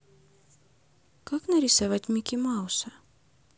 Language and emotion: Russian, neutral